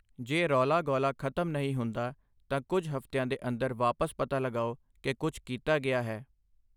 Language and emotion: Punjabi, neutral